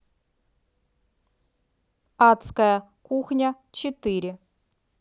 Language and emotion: Russian, neutral